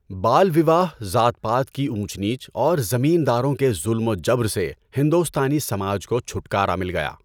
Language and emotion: Urdu, neutral